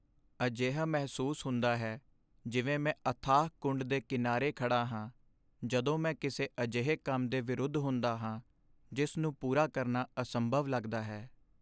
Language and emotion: Punjabi, sad